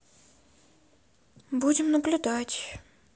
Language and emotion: Russian, sad